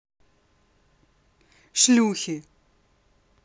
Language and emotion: Russian, angry